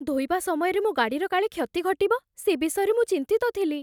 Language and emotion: Odia, fearful